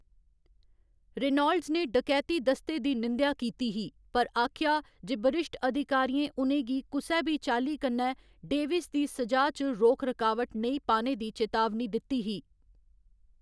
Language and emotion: Dogri, neutral